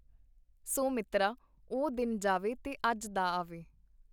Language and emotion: Punjabi, neutral